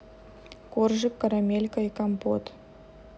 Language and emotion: Russian, neutral